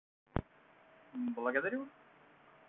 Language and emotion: Russian, positive